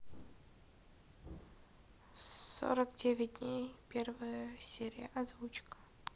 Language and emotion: Russian, neutral